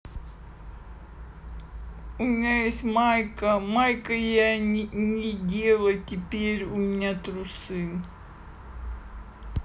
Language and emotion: Russian, neutral